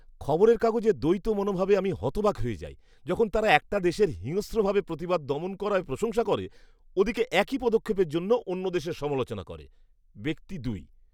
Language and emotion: Bengali, disgusted